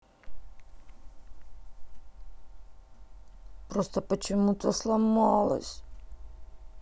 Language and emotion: Russian, sad